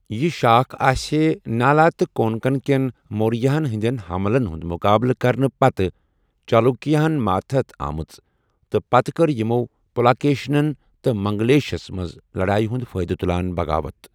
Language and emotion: Kashmiri, neutral